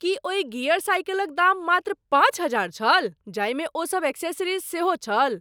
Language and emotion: Maithili, surprised